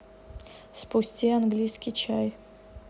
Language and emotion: Russian, neutral